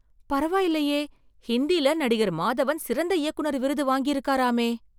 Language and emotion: Tamil, surprised